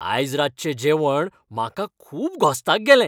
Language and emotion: Goan Konkani, happy